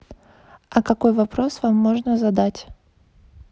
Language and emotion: Russian, neutral